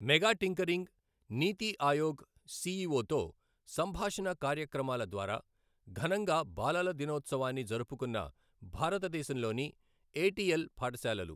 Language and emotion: Telugu, neutral